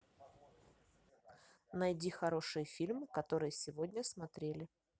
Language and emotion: Russian, neutral